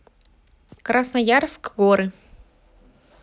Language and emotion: Russian, neutral